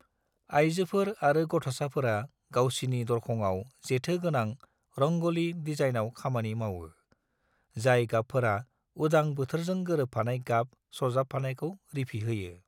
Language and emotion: Bodo, neutral